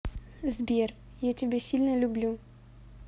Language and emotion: Russian, positive